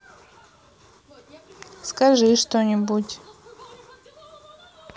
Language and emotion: Russian, neutral